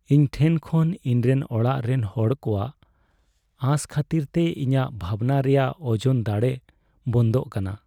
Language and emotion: Santali, sad